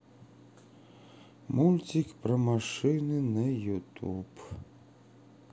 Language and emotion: Russian, sad